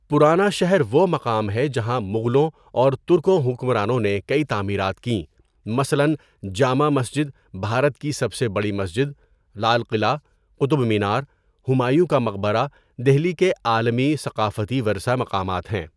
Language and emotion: Urdu, neutral